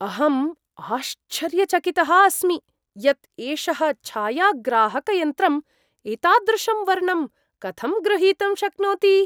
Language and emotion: Sanskrit, surprised